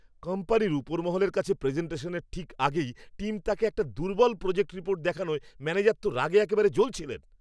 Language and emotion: Bengali, angry